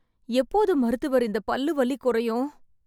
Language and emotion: Tamil, fearful